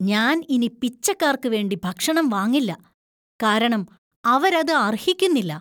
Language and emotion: Malayalam, disgusted